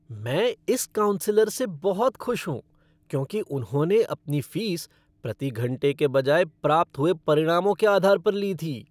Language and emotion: Hindi, happy